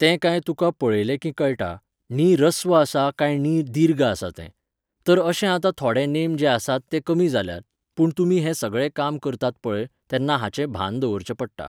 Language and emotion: Goan Konkani, neutral